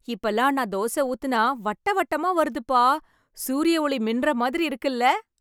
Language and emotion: Tamil, happy